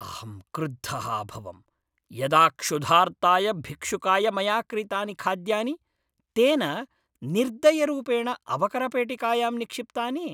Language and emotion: Sanskrit, angry